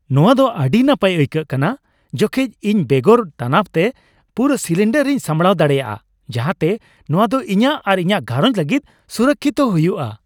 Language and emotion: Santali, happy